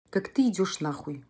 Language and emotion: Russian, angry